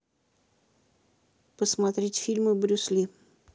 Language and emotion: Russian, neutral